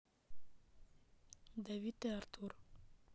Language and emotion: Russian, neutral